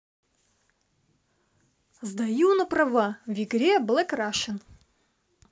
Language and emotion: Russian, positive